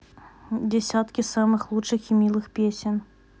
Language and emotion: Russian, neutral